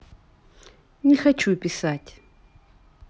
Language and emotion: Russian, neutral